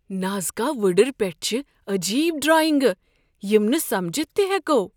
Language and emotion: Kashmiri, surprised